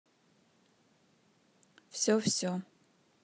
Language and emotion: Russian, neutral